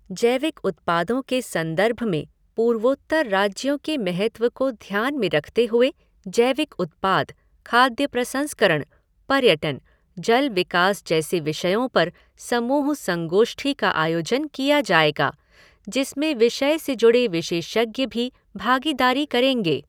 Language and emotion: Hindi, neutral